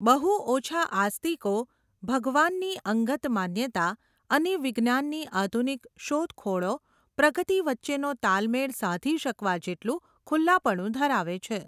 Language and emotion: Gujarati, neutral